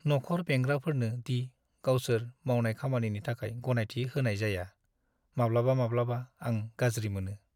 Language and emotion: Bodo, sad